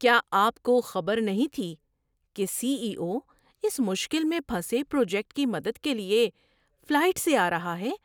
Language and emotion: Urdu, surprised